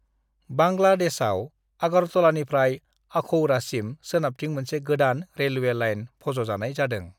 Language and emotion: Bodo, neutral